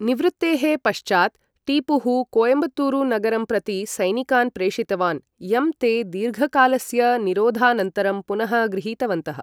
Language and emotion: Sanskrit, neutral